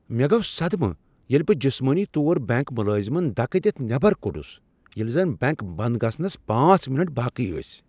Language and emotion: Kashmiri, surprised